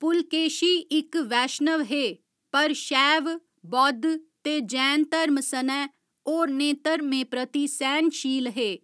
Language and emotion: Dogri, neutral